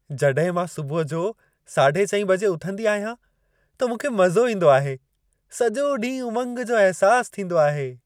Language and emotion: Sindhi, happy